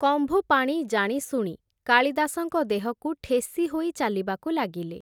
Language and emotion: Odia, neutral